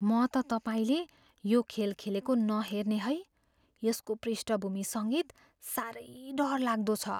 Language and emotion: Nepali, fearful